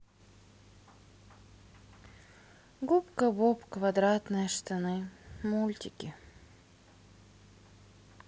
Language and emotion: Russian, sad